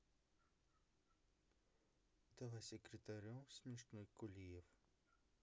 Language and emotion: Russian, neutral